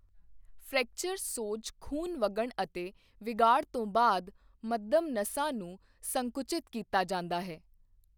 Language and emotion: Punjabi, neutral